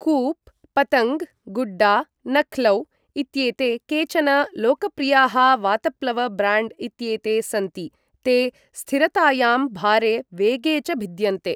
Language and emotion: Sanskrit, neutral